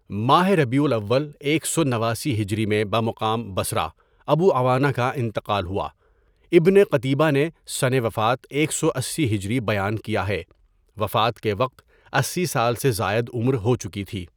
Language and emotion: Urdu, neutral